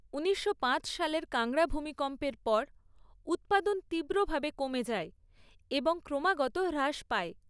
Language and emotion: Bengali, neutral